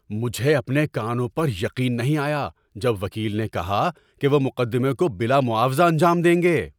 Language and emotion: Urdu, surprised